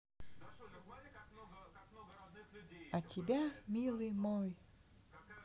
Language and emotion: Russian, neutral